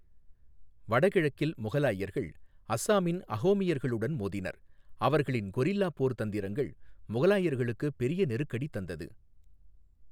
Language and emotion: Tamil, neutral